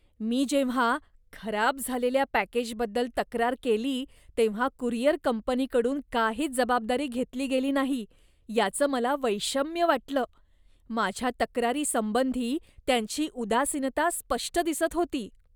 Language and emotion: Marathi, disgusted